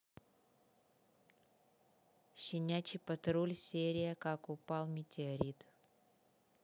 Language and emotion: Russian, neutral